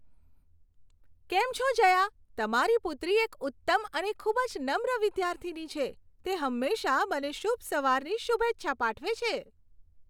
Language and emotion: Gujarati, happy